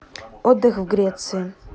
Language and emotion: Russian, neutral